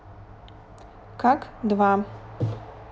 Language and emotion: Russian, neutral